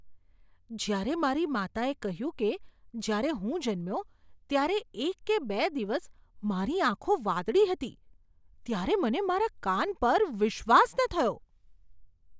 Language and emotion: Gujarati, surprised